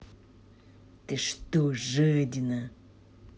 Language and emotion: Russian, angry